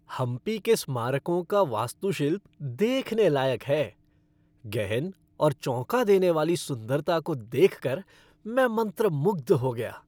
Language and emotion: Hindi, happy